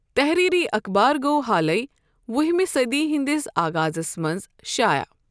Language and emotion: Kashmiri, neutral